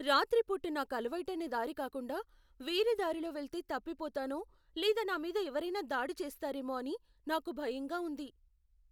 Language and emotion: Telugu, fearful